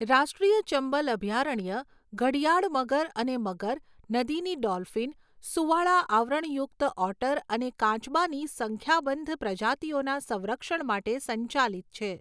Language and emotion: Gujarati, neutral